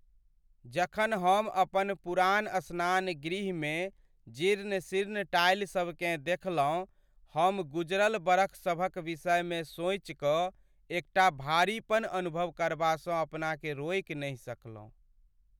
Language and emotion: Maithili, sad